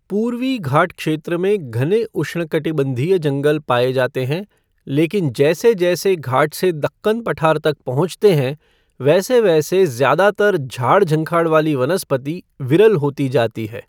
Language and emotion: Hindi, neutral